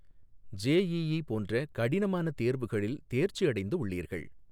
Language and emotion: Tamil, neutral